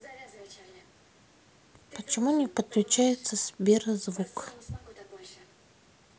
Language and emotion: Russian, neutral